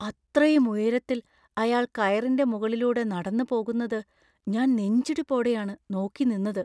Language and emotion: Malayalam, fearful